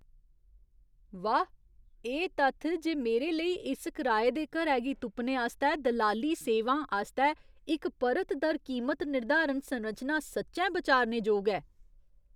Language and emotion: Dogri, surprised